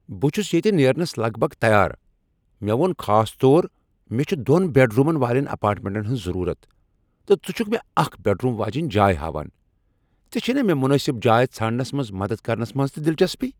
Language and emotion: Kashmiri, angry